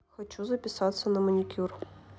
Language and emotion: Russian, neutral